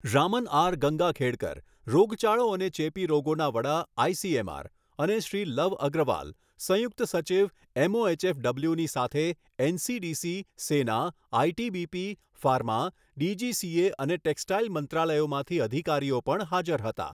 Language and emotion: Gujarati, neutral